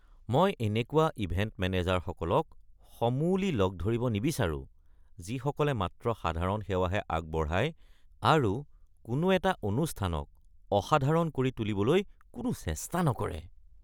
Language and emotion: Assamese, disgusted